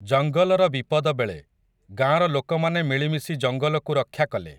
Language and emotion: Odia, neutral